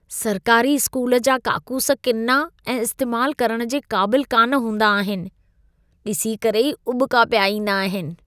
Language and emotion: Sindhi, disgusted